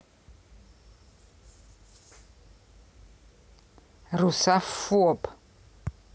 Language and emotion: Russian, angry